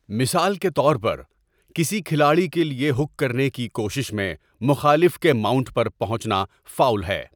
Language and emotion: Urdu, neutral